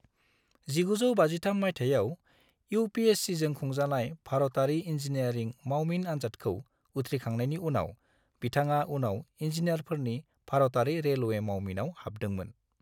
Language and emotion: Bodo, neutral